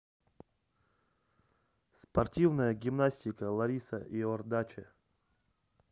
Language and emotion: Russian, neutral